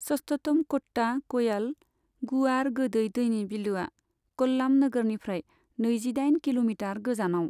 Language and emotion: Bodo, neutral